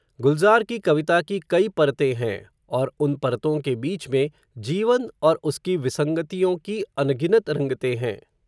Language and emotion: Hindi, neutral